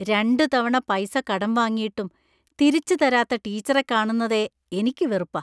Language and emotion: Malayalam, disgusted